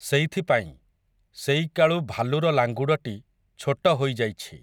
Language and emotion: Odia, neutral